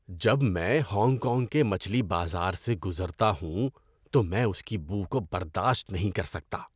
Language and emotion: Urdu, disgusted